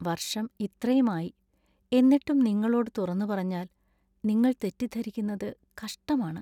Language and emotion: Malayalam, sad